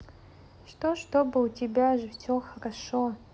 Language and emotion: Russian, neutral